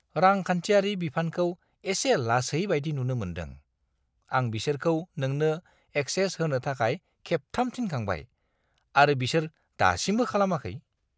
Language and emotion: Bodo, disgusted